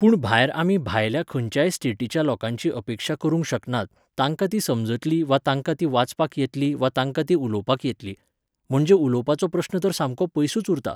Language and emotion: Goan Konkani, neutral